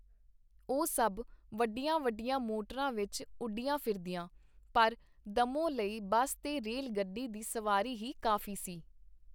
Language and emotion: Punjabi, neutral